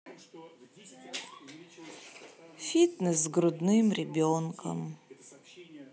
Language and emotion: Russian, sad